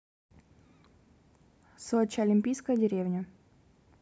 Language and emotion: Russian, neutral